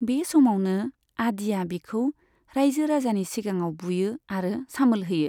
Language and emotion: Bodo, neutral